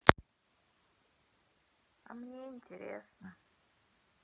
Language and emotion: Russian, sad